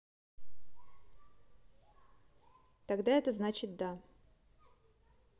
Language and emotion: Russian, neutral